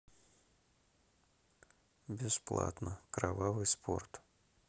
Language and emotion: Russian, sad